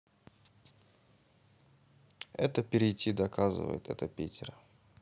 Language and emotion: Russian, neutral